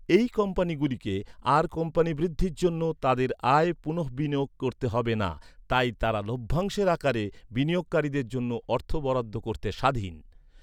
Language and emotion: Bengali, neutral